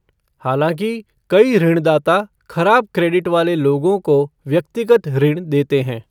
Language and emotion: Hindi, neutral